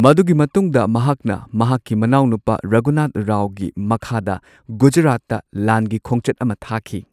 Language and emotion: Manipuri, neutral